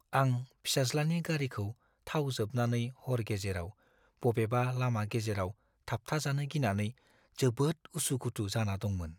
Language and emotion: Bodo, fearful